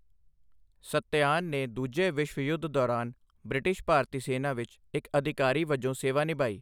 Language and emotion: Punjabi, neutral